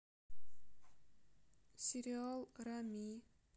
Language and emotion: Russian, sad